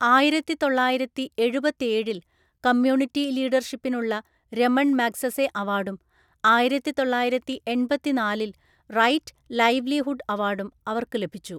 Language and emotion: Malayalam, neutral